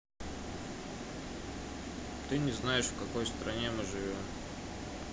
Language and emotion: Russian, neutral